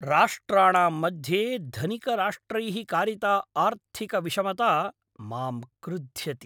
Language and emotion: Sanskrit, angry